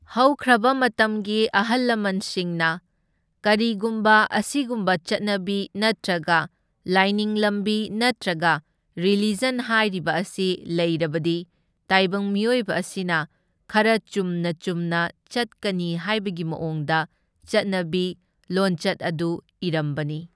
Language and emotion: Manipuri, neutral